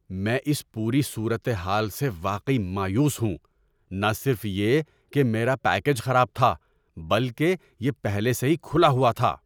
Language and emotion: Urdu, angry